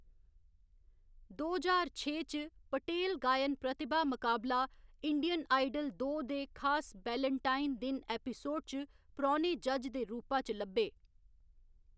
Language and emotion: Dogri, neutral